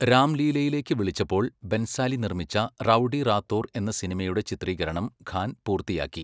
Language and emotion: Malayalam, neutral